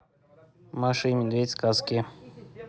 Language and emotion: Russian, neutral